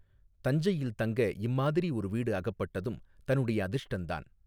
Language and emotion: Tamil, neutral